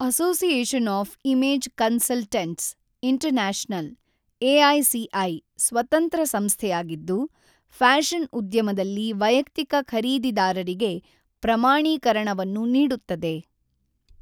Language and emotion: Kannada, neutral